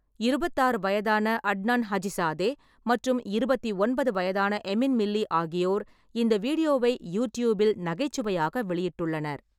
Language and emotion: Tamil, neutral